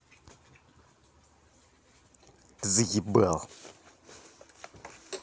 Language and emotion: Russian, angry